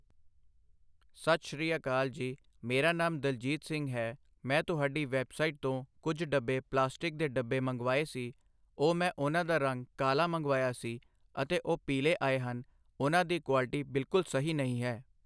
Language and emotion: Punjabi, neutral